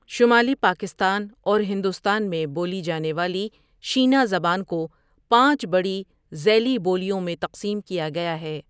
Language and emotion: Urdu, neutral